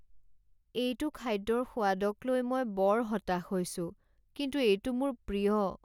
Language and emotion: Assamese, sad